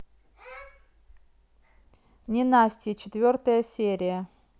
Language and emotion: Russian, neutral